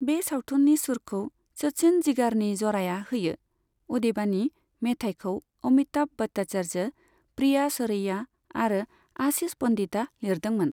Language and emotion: Bodo, neutral